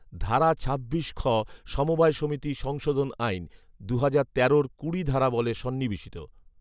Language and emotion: Bengali, neutral